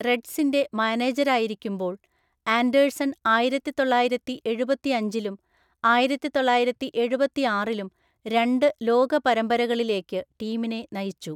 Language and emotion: Malayalam, neutral